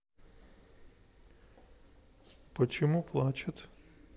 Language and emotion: Russian, sad